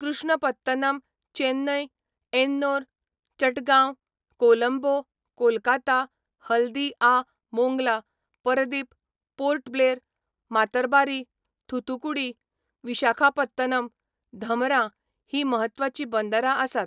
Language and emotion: Goan Konkani, neutral